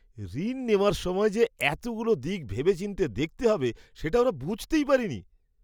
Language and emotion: Bengali, surprised